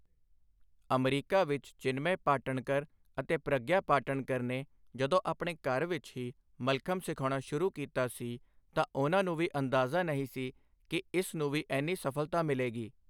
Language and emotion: Punjabi, neutral